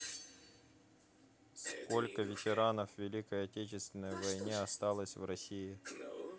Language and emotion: Russian, neutral